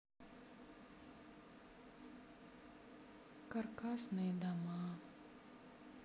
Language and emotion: Russian, sad